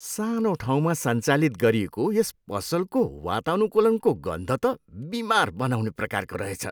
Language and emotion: Nepali, disgusted